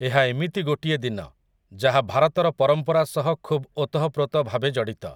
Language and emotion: Odia, neutral